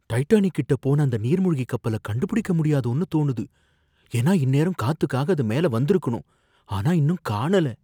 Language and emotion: Tamil, fearful